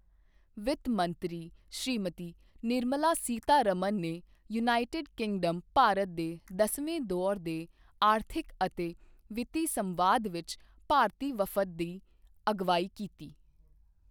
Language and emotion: Punjabi, neutral